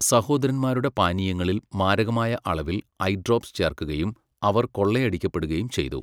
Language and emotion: Malayalam, neutral